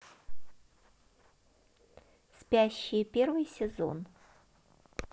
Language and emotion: Russian, positive